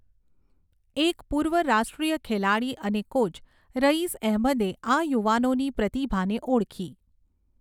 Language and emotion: Gujarati, neutral